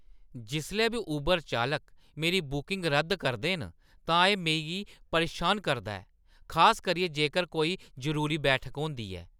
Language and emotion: Dogri, angry